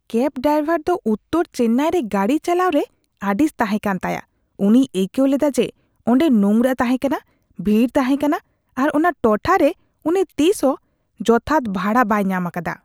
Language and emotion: Santali, disgusted